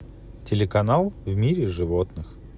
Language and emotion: Russian, neutral